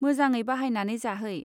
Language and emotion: Bodo, neutral